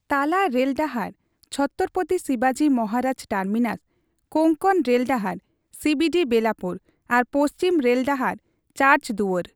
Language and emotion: Santali, neutral